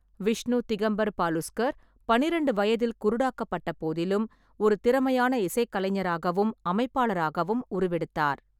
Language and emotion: Tamil, neutral